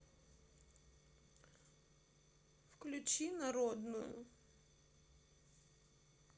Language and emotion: Russian, sad